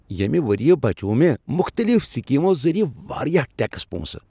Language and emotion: Kashmiri, happy